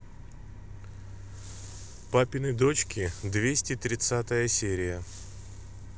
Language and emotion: Russian, neutral